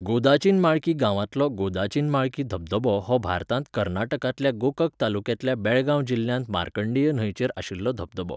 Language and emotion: Goan Konkani, neutral